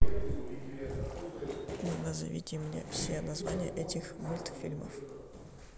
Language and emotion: Russian, neutral